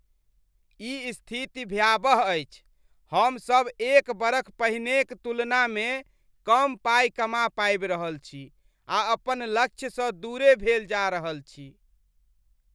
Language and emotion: Maithili, disgusted